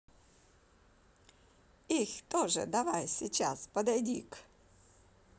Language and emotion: Russian, positive